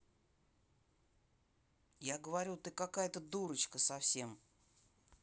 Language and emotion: Russian, neutral